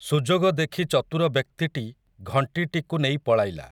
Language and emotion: Odia, neutral